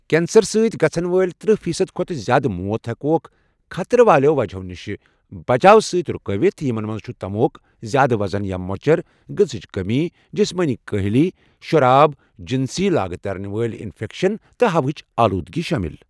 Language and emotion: Kashmiri, neutral